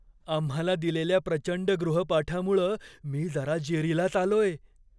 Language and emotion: Marathi, fearful